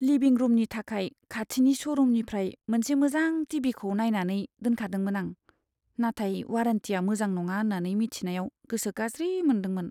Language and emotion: Bodo, sad